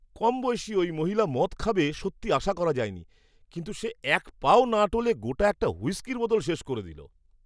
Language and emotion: Bengali, surprised